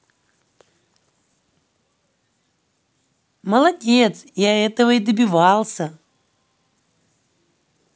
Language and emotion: Russian, positive